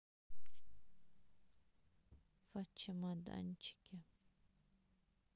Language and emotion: Russian, sad